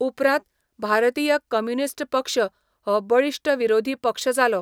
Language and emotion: Goan Konkani, neutral